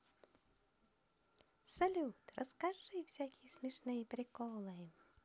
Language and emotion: Russian, positive